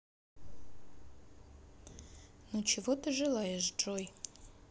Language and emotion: Russian, neutral